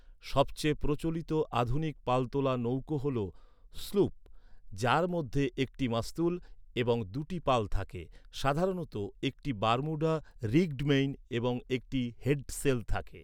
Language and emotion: Bengali, neutral